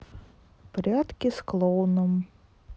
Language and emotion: Russian, neutral